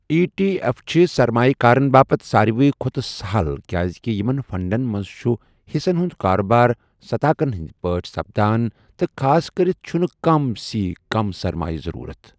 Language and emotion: Kashmiri, neutral